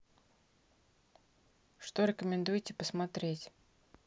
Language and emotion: Russian, neutral